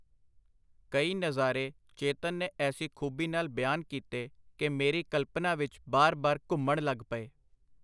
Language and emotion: Punjabi, neutral